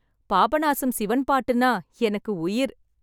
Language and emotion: Tamil, happy